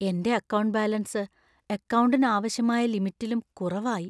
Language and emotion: Malayalam, fearful